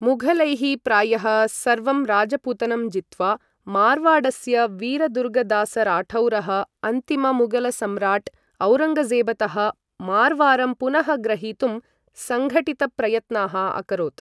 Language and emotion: Sanskrit, neutral